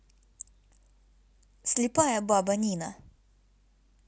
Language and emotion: Russian, neutral